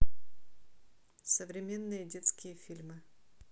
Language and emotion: Russian, neutral